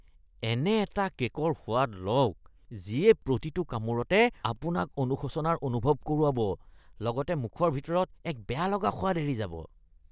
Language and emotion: Assamese, disgusted